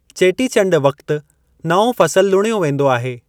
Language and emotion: Sindhi, neutral